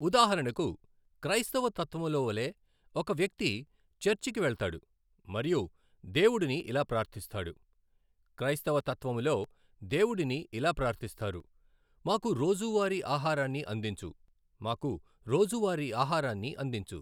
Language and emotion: Telugu, neutral